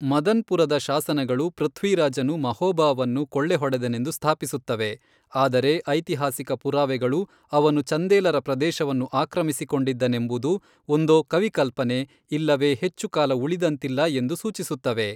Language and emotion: Kannada, neutral